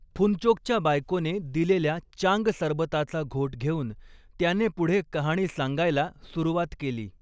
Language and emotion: Marathi, neutral